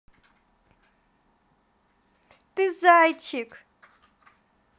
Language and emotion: Russian, positive